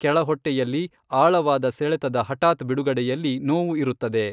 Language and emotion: Kannada, neutral